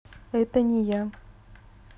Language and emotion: Russian, neutral